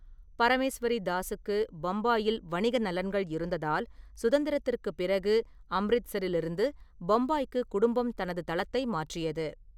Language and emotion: Tamil, neutral